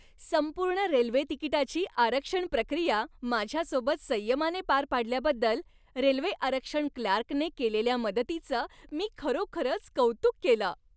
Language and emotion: Marathi, happy